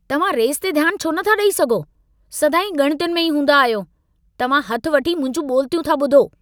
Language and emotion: Sindhi, angry